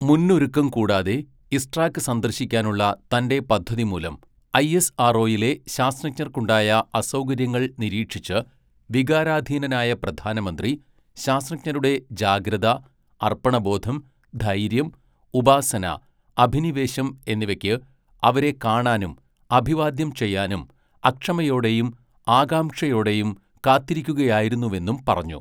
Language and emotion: Malayalam, neutral